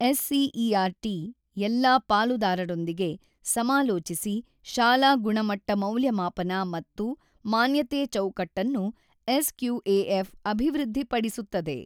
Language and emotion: Kannada, neutral